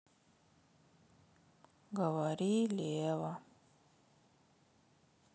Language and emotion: Russian, sad